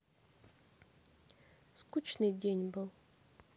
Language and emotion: Russian, sad